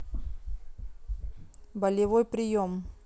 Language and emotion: Russian, neutral